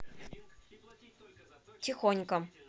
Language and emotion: Russian, neutral